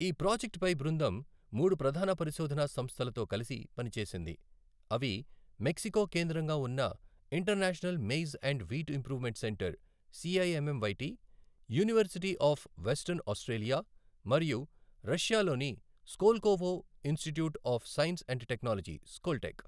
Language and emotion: Telugu, neutral